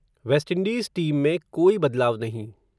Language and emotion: Hindi, neutral